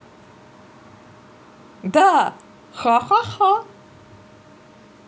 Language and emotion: Russian, positive